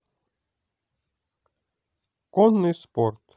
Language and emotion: Russian, positive